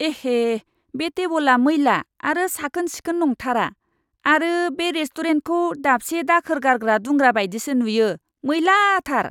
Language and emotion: Bodo, disgusted